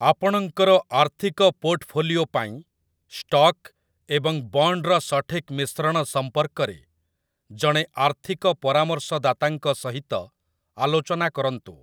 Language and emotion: Odia, neutral